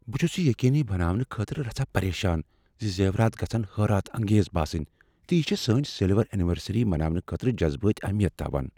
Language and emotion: Kashmiri, fearful